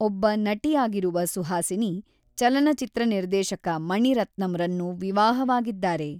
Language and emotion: Kannada, neutral